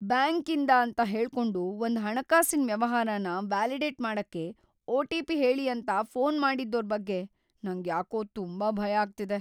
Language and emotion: Kannada, fearful